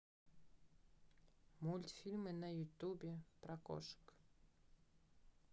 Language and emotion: Russian, neutral